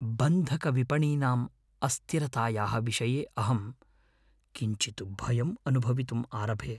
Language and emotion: Sanskrit, fearful